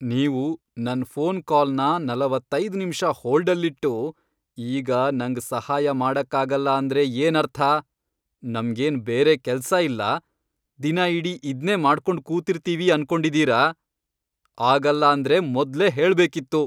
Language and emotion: Kannada, angry